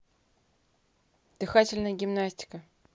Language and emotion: Russian, neutral